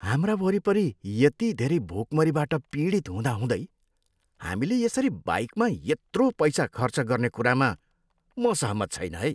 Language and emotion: Nepali, disgusted